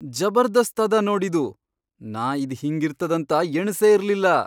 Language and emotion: Kannada, surprised